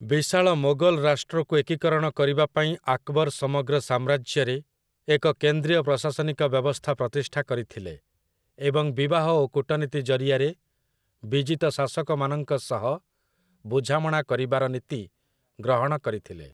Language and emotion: Odia, neutral